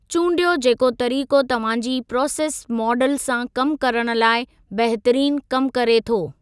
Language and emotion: Sindhi, neutral